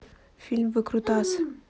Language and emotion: Russian, neutral